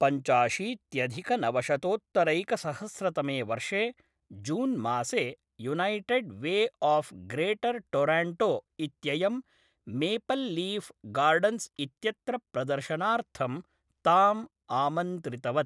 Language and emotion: Sanskrit, neutral